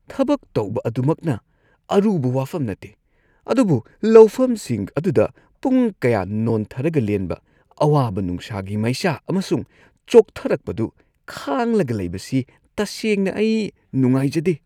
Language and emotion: Manipuri, disgusted